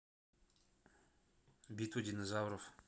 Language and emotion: Russian, neutral